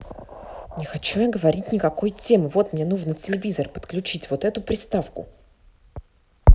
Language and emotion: Russian, angry